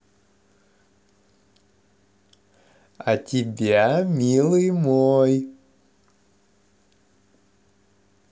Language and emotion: Russian, positive